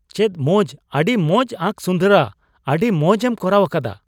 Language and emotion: Santali, surprised